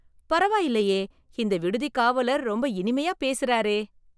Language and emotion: Tamil, surprised